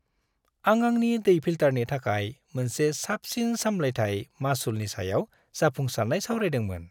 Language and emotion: Bodo, happy